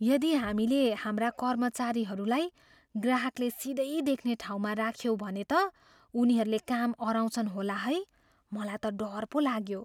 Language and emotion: Nepali, fearful